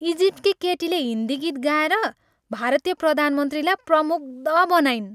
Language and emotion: Nepali, happy